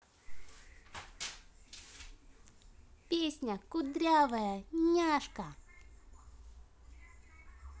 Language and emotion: Russian, positive